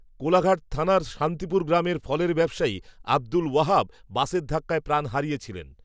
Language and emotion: Bengali, neutral